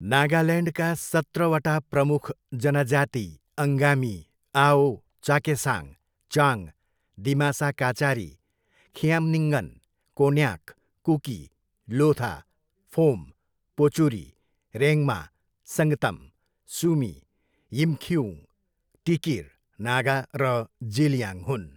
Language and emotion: Nepali, neutral